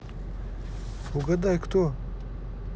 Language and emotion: Russian, neutral